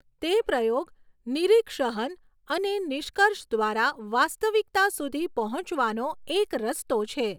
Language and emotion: Gujarati, neutral